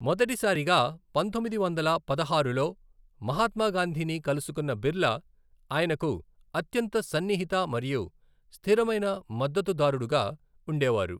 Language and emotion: Telugu, neutral